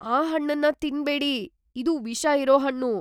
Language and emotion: Kannada, fearful